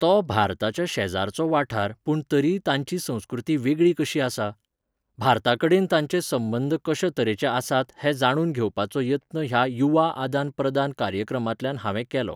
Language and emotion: Goan Konkani, neutral